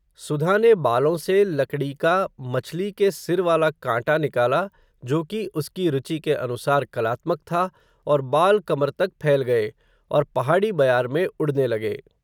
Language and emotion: Hindi, neutral